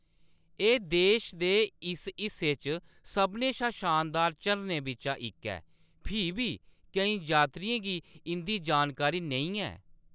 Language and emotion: Dogri, neutral